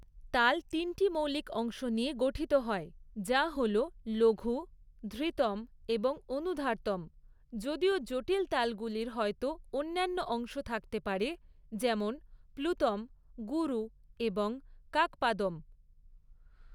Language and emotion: Bengali, neutral